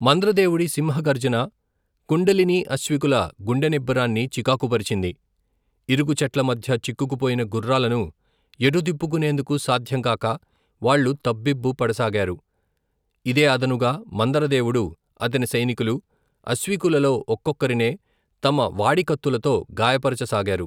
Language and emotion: Telugu, neutral